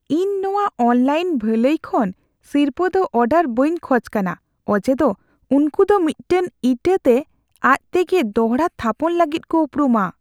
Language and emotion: Santali, fearful